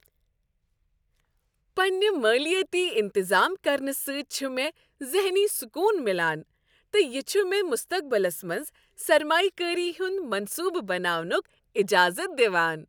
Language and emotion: Kashmiri, happy